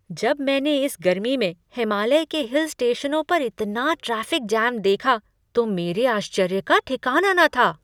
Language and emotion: Hindi, surprised